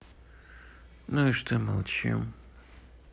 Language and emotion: Russian, sad